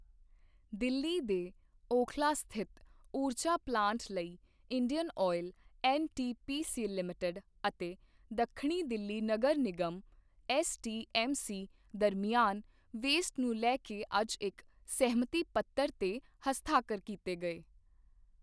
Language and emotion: Punjabi, neutral